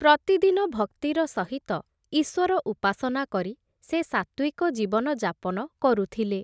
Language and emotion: Odia, neutral